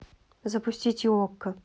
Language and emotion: Russian, neutral